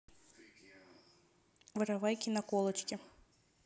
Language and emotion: Russian, neutral